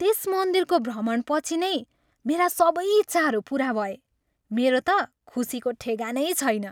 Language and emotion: Nepali, happy